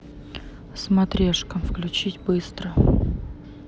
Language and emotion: Russian, neutral